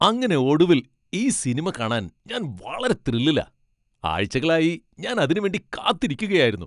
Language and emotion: Malayalam, happy